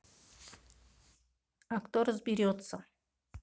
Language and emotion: Russian, neutral